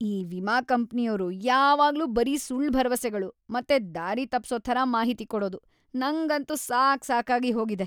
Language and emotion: Kannada, disgusted